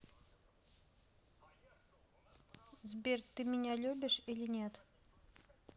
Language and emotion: Russian, neutral